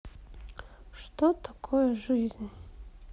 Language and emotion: Russian, sad